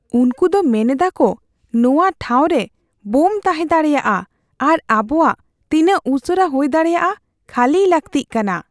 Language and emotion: Santali, fearful